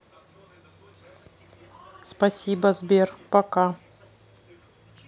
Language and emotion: Russian, neutral